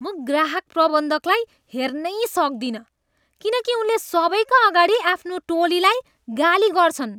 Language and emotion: Nepali, disgusted